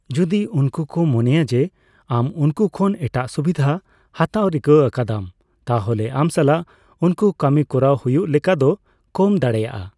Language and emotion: Santali, neutral